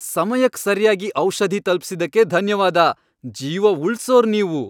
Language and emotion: Kannada, happy